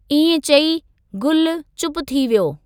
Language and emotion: Sindhi, neutral